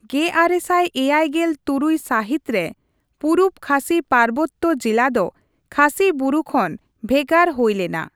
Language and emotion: Santali, neutral